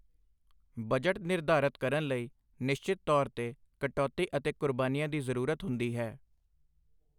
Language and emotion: Punjabi, neutral